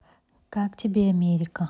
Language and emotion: Russian, neutral